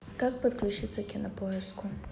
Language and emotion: Russian, neutral